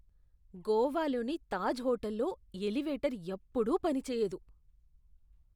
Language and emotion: Telugu, disgusted